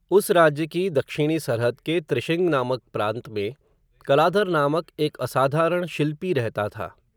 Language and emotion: Hindi, neutral